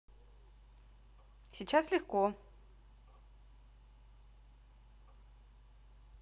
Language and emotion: Russian, positive